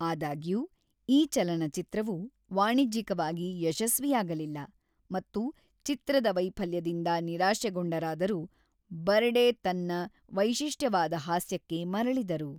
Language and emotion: Kannada, neutral